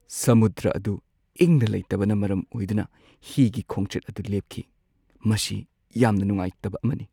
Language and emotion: Manipuri, sad